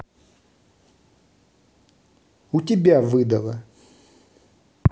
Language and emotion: Russian, angry